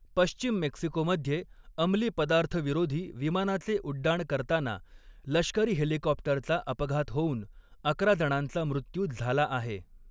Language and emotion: Marathi, neutral